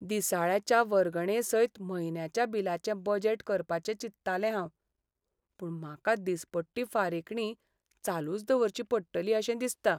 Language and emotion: Goan Konkani, sad